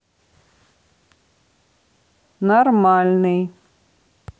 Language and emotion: Russian, neutral